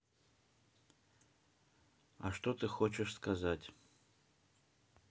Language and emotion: Russian, neutral